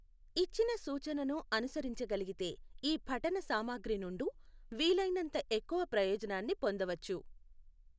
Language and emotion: Telugu, neutral